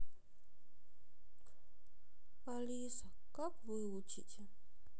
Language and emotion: Russian, sad